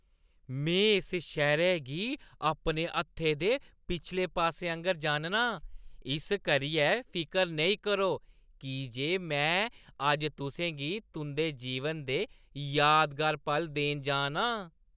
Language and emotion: Dogri, happy